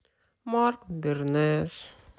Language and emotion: Russian, sad